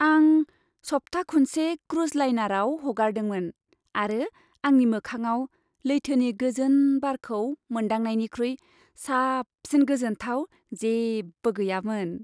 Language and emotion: Bodo, happy